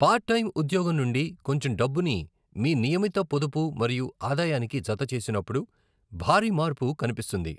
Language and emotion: Telugu, neutral